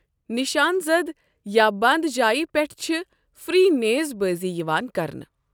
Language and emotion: Kashmiri, neutral